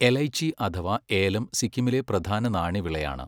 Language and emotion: Malayalam, neutral